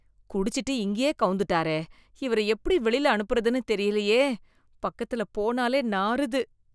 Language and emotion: Tamil, disgusted